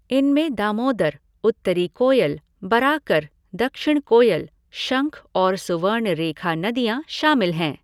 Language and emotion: Hindi, neutral